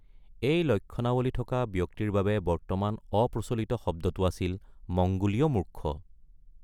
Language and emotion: Assamese, neutral